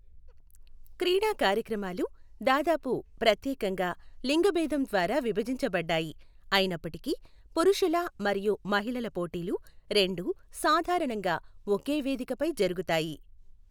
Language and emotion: Telugu, neutral